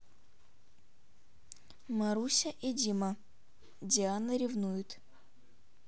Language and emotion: Russian, neutral